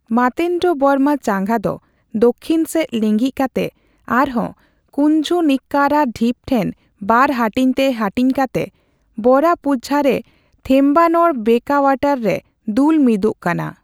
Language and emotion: Santali, neutral